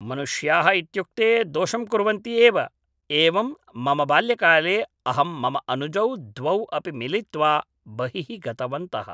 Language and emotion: Sanskrit, neutral